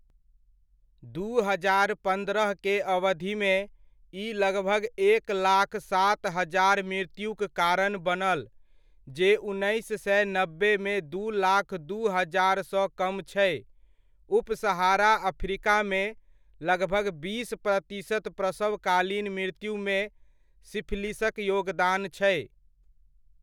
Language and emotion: Maithili, neutral